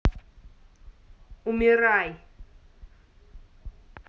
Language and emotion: Russian, angry